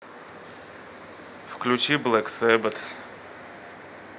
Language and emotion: Russian, neutral